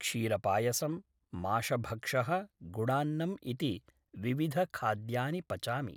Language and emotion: Sanskrit, neutral